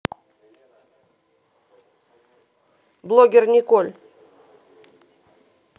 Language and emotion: Russian, neutral